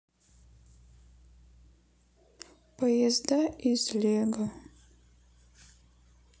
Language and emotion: Russian, sad